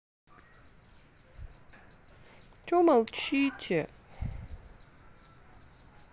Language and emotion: Russian, sad